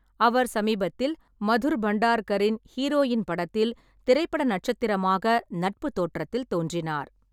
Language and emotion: Tamil, neutral